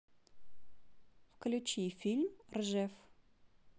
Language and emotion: Russian, neutral